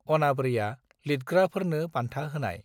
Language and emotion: Bodo, neutral